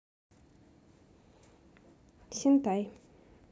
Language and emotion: Russian, neutral